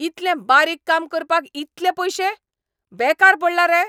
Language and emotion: Goan Konkani, angry